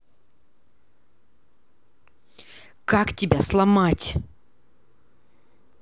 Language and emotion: Russian, angry